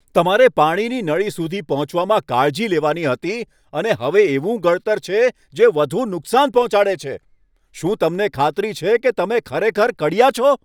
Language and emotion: Gujarati, angry